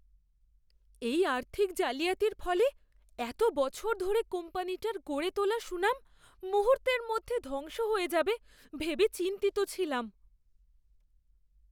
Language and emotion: Bengali, fearful